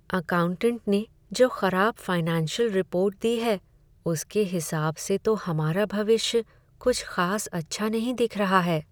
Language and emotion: Hindi, sad